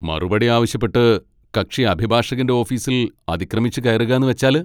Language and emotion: Malayalam, angry